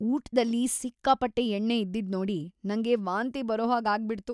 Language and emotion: Kannada, disgusted